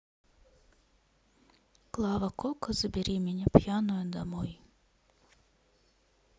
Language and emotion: Russian, sad